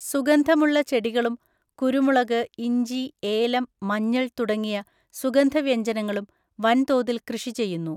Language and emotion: Malayalam, neutral